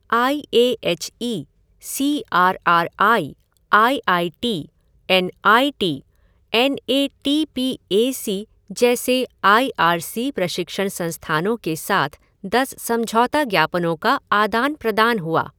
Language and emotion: Hindi, neutral